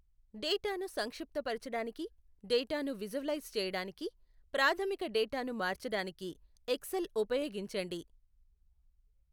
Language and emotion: Telugu, neutral